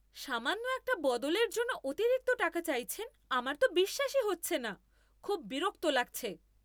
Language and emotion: Bengali, angry